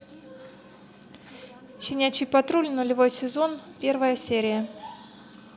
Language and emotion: Russian, neutral